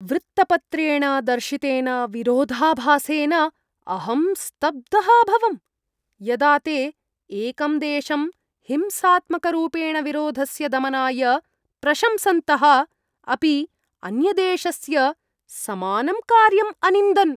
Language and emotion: Sanskrit, disgusted